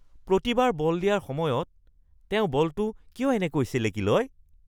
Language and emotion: Assamese, disgusted